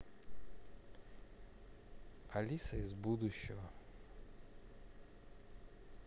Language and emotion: Russian, neutral